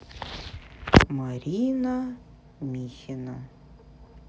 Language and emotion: Russian, neutral